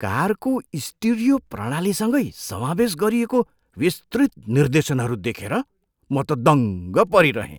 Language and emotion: Nepali, surprised